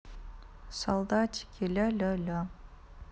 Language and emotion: Russian, sad